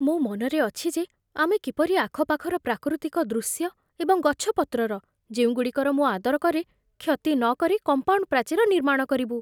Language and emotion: Odia, fearful